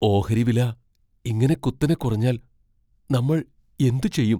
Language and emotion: Malayalam, fearful